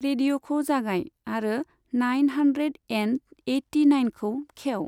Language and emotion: Bodo, neutral